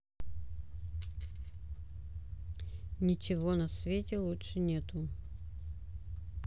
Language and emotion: Russian, neutral